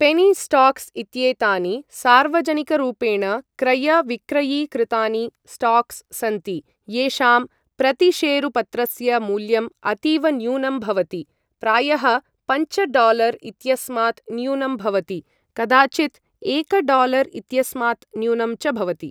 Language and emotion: Sanskrit, neutral